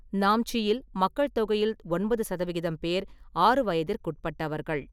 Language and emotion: Tamil, neutral